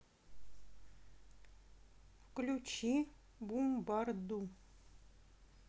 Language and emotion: Russian, neutral